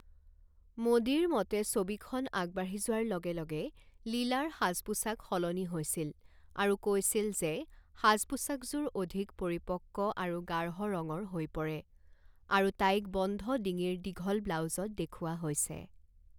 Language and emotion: Assamese, neutral